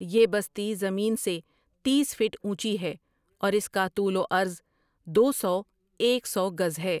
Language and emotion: Urdu, neutral